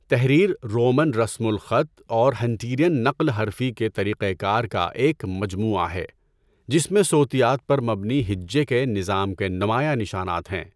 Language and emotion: Urdu, neutral